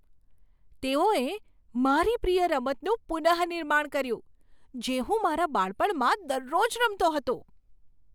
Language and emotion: Gujarati, surprised